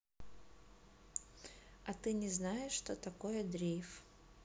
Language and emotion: Russian, neutral